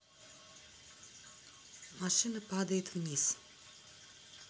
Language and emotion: Russian, neutral